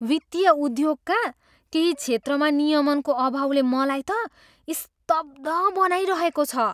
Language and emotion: Nepali, surprised